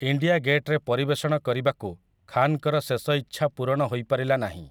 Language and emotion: Odia, neutral